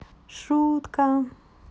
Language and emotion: Russian, positive